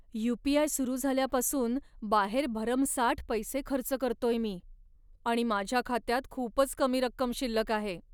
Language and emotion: Marathi, sad